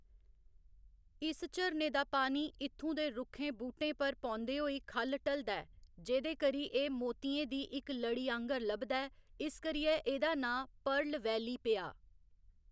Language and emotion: Dogri, neutral